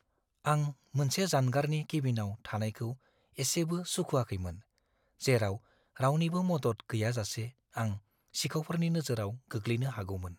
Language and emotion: Bodo, fearful